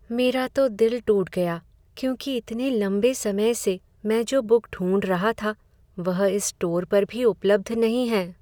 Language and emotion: Hindi, sad